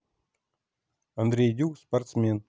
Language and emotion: Russian, neutral